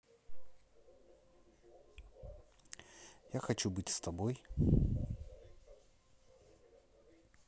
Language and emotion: Russian, neutral